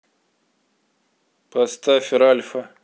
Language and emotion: Russian, neutral